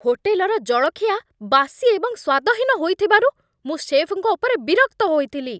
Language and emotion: Odia, angry